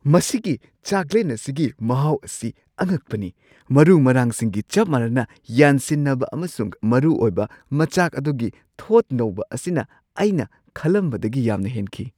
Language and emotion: Manipuri, surprised